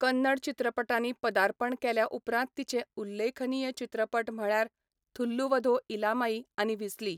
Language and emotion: Goan Konkani, neutral